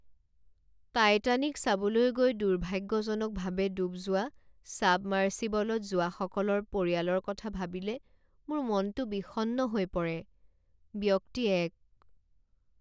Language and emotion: Assamese, sad